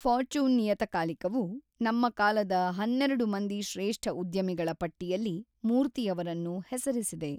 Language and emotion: Kannada, neutral